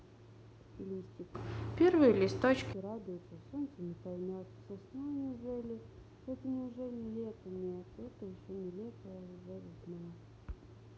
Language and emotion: Russian, neutral